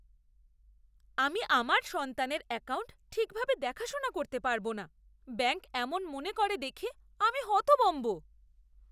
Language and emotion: Bengali, disgusted